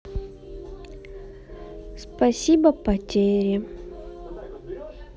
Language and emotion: Russian, sad